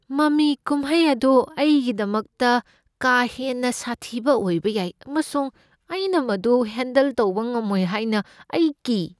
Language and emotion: Manipuri, fearful